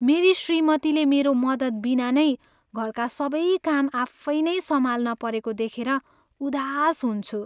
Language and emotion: Nepali, sad